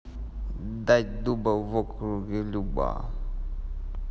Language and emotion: Russian, neutral